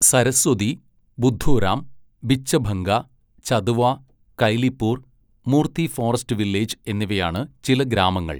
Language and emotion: Malayalam, neutral